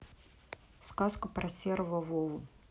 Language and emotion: Russian, neutral